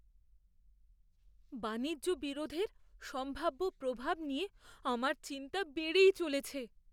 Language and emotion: Bengali, fearful